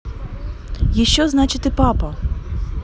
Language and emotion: Russian, neutral